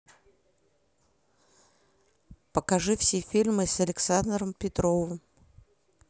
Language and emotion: Russian, neutral